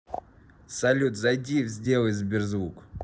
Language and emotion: Russian, neutral